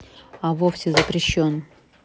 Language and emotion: Russian, neutral